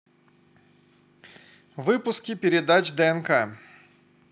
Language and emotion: Russian, positive